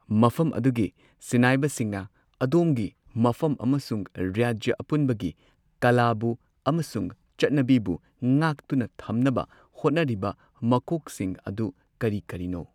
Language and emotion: Manipuri, neutral